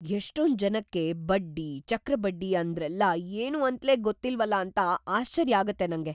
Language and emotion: Kannada, surprised